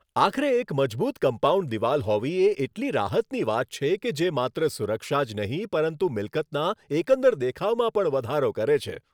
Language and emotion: Gujarati, happy